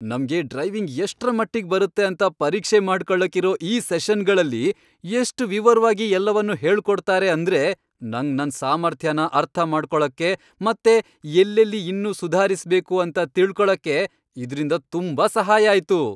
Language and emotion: Kannada, happy